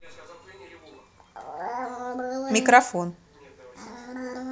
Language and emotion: Russian, neutral